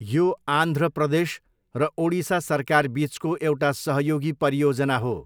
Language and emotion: Nepali, neutral